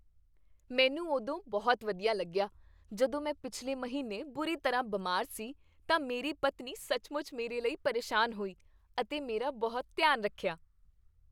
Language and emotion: Punjabi, happy